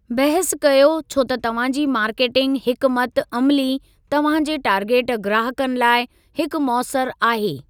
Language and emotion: Sindhi, neutral